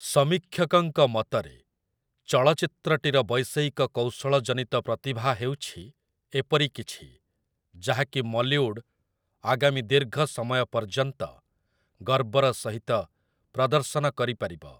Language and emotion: Odia, neutral